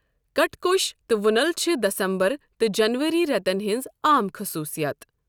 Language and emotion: Kashmiri, neutral